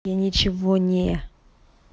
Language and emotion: Russian, neutral